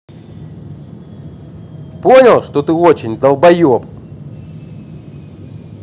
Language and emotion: Russian, angry